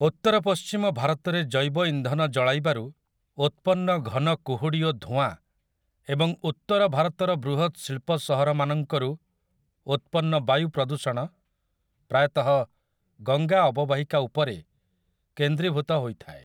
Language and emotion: Odia, neutral